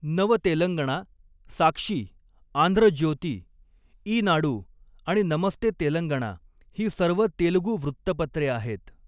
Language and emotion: Marathi, neutral